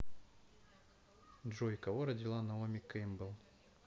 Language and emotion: Russian, neutral